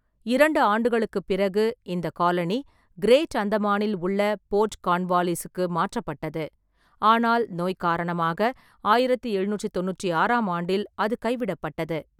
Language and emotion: Tamil, neutral